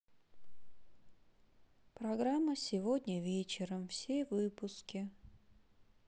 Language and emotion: Russian, sad